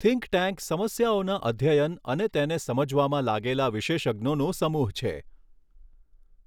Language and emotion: Gujarati, neutral